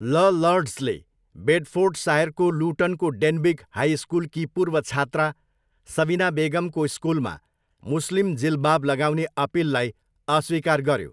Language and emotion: Nepali, neutral